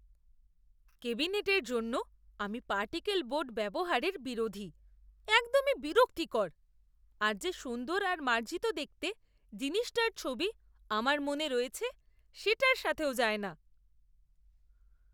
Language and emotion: Bengali, disgusted